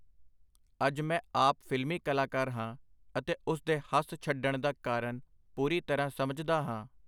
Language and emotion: Punjabi, neutral